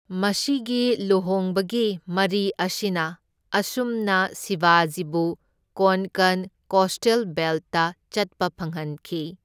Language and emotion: Manipuri, neutral